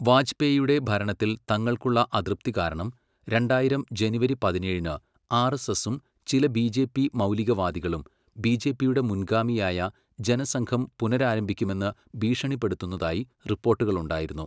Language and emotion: Malayalam, neutral